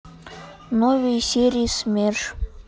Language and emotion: Russian, neutral